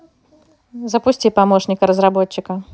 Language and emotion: Russian, neutral